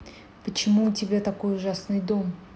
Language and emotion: Russian, neutral